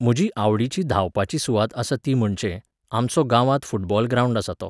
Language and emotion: Goan Konkani, neutral